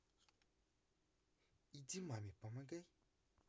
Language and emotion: Russian, neutral